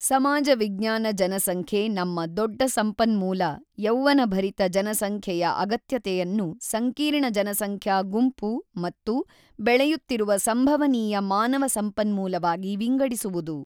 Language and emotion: Kannada, neutral